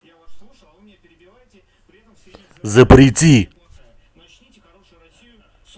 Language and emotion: Russian, angry